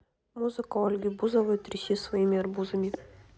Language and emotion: Russian, neutral